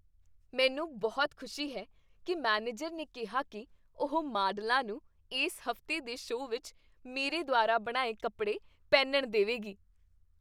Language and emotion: Punjabi, happy